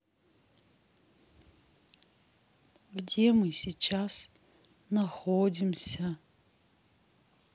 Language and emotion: Russian, sad